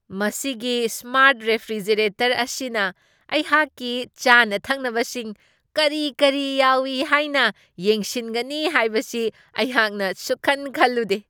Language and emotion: Manipuri, surprised